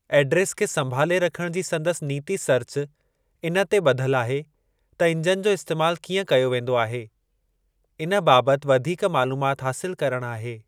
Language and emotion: Sindhi, neutral